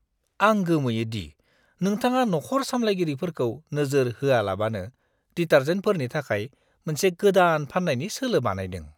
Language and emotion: Bodo, disgusted